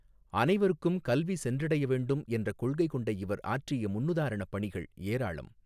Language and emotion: Tamil, neutral